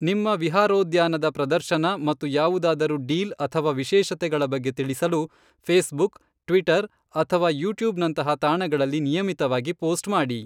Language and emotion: Kannada, neutral